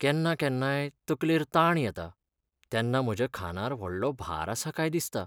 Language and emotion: Goan Konkani, sad